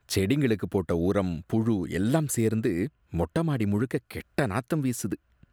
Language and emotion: Tamil, disgusted